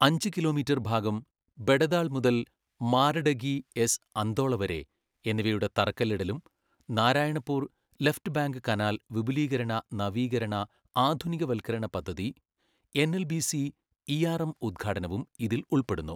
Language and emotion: Malayalam, neutral